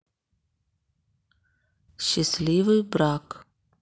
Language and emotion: Russian, neutral